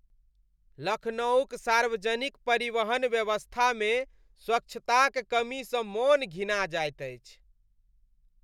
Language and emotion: Maithili, disgusted